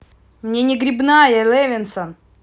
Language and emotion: Russian, angry